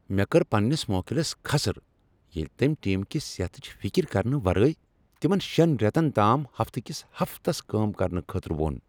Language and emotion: Kashmiri, angry